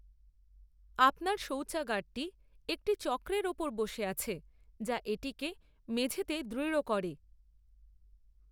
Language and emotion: Bengali, neutral